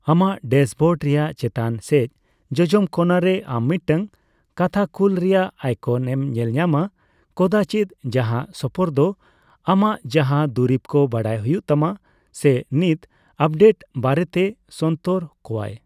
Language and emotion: Santali, neutral